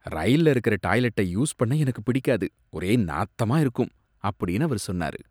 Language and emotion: Tamil, disgusted